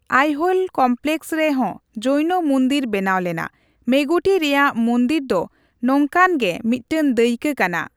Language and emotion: Santali, neutral